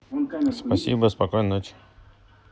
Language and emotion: Russian, neutral